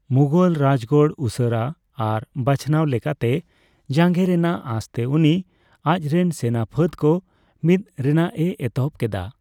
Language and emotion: Santali, neutral